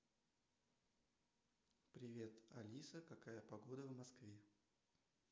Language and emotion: Russian, neutral